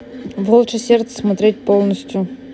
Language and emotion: Russian, neutral